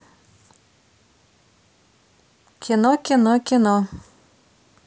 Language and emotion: Russian, neutral